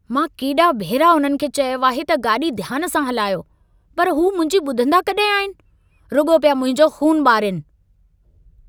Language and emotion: Sindhi, angry